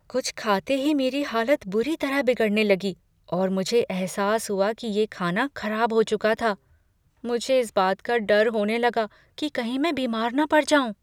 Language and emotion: Hindi, fearful